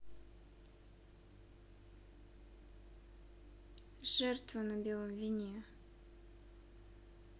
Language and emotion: Russian, neutral